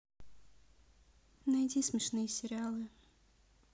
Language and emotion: Russian, neutral